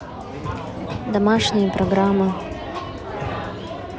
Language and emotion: Russian, neutral